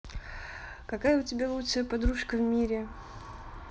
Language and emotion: Russian, neutral